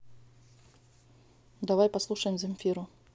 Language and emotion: Russian, neutral